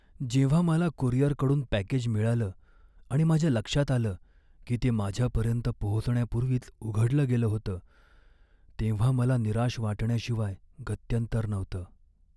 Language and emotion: Marathi, sad